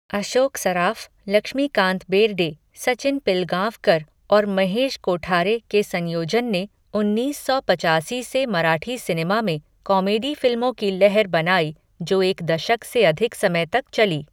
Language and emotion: Hindi, neutral